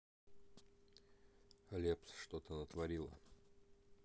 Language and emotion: Russian, neutral